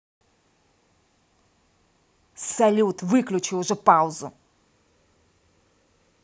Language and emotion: Russian, angry